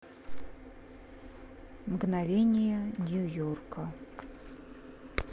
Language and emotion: Russian, neutral